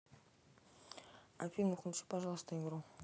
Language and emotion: Russian, neutral